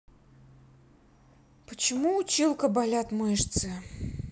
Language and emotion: Russian, sad